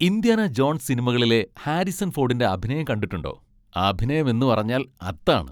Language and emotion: Malayalam, happy